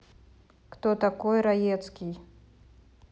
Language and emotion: Russian, neutral